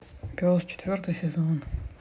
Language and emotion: Russian, neutral